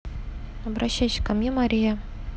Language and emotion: Russian, neutral